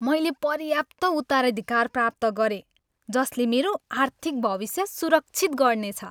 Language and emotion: Nepali, happy